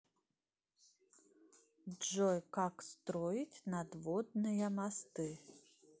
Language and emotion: Russian, neutral